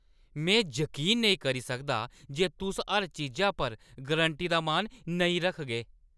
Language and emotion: Dogri, angry